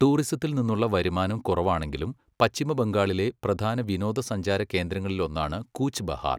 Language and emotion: Malayalam, neutral